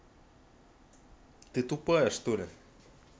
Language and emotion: Russian, angry